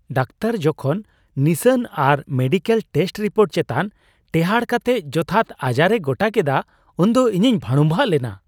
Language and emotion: Santali, surprised